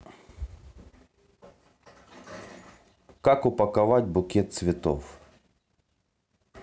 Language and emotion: Russian, neutral